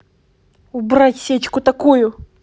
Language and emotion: Russian, angry